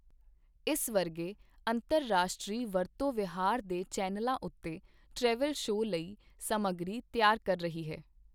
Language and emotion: Punjabi, neutral